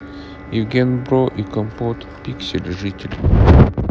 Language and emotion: Russian, neutral